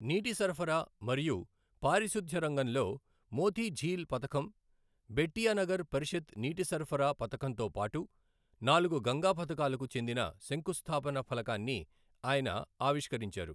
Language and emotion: Telugu, neutral